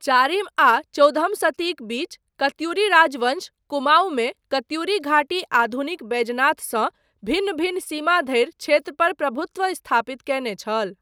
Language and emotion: Maithili, neutral